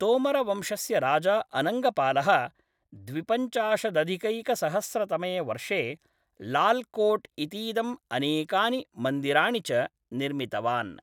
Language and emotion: Sanskrit, neutral